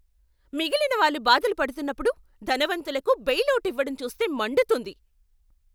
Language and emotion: Telugu, angry